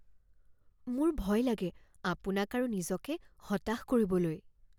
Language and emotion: Assamese, fearful